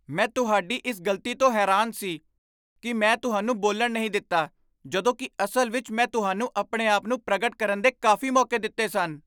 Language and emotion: Punjabi, surprised